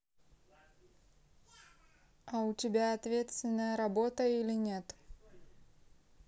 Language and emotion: Russian, neutral